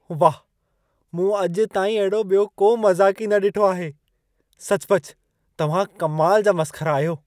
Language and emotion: Sindhi, surprised